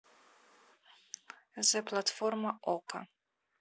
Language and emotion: Russian, neutral